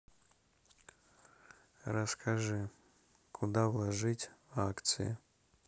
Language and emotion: Russian, neutral